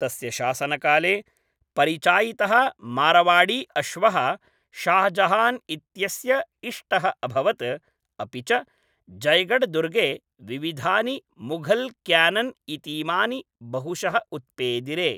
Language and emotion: Sanskrit, neutral